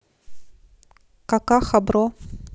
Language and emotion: Russian, neutral